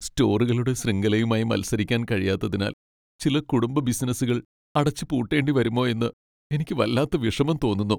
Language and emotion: Malayalam, sad